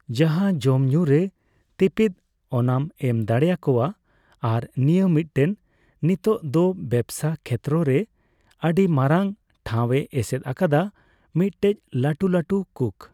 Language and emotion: Santali, neutral